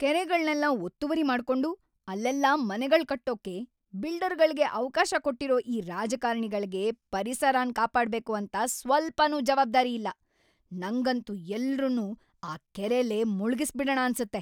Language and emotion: Kannada, angry